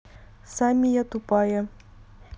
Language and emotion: Russian, neutral